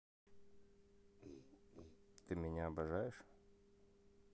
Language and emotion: Russian, positive